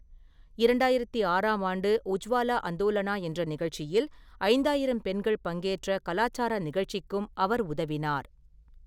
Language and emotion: Tamil, neutral